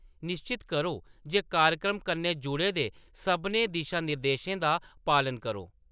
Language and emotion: Dogri, neutral